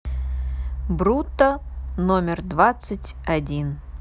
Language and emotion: Russian, neutral